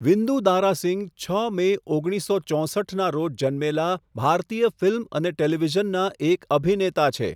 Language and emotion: Gujarati, neutral